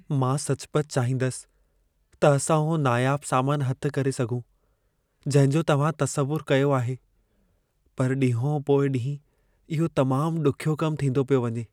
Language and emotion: Sindhi, sad